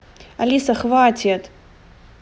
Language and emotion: Russian, angry